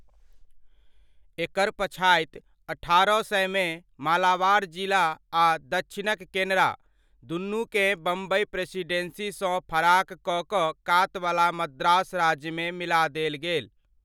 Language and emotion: Maithili, neutral